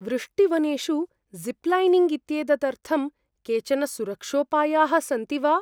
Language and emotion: Sanskrit, fearful